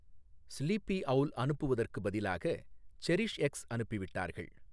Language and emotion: Tamil, neutral